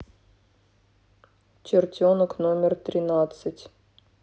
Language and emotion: Russian, neutral